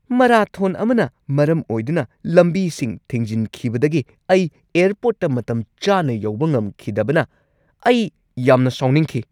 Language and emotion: Manipuri, angry